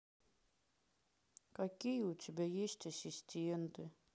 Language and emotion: Russian, sad